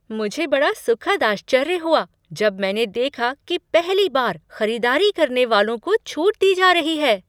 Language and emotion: Hindi, surprised